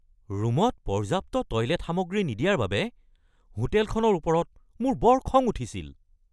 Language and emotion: Assamese, angry